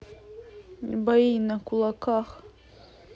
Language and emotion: Russian, neutral